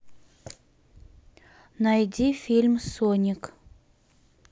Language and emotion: Russian, neutral